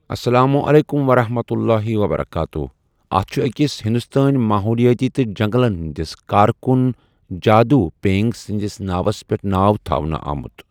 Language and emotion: Kashmiri, neutral